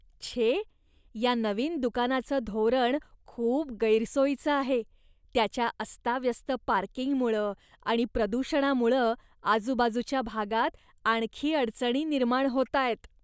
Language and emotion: Marathi, disgusted